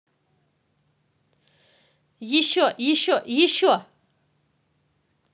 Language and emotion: Russian, positive